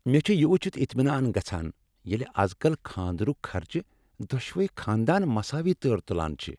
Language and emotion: Kashmiri, happy